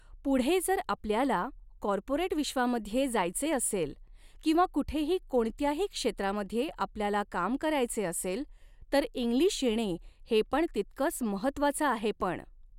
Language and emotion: Marathi, neutral